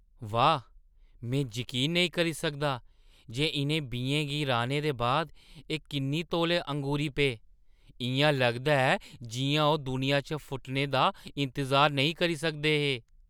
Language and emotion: Dogri, surprised